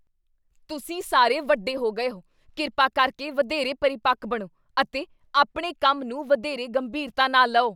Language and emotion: Punjabi, angry